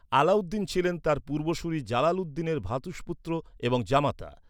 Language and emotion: Bengali, neutral